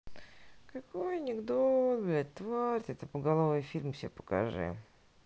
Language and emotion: Russian, sad